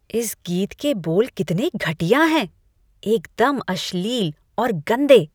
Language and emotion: Hindi, disgusted